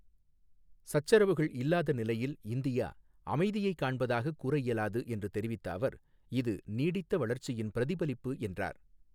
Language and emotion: Tamil, neutral